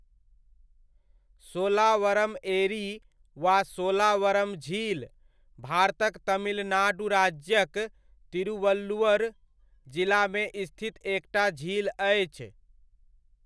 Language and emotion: Maithili, neutral